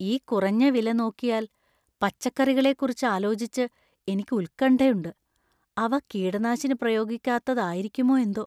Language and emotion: Malayalam, fearful